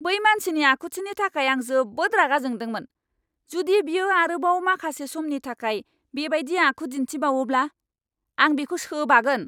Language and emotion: Bodo, angry